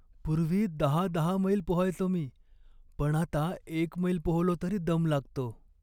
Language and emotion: Marathi, sad